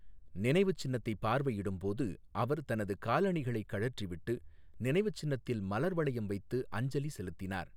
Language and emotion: Tamil, neutral